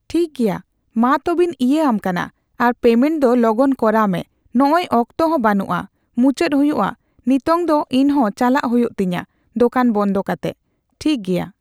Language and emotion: Santali, neutral